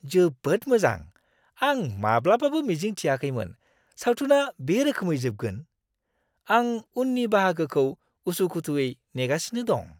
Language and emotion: Bodo, surprised